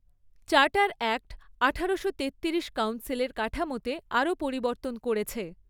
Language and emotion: Bengali, neutral